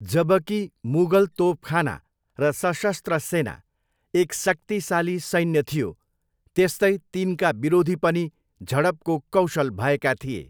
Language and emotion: Nepali, neutral